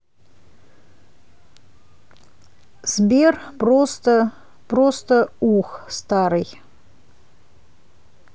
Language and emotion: Russian, neutral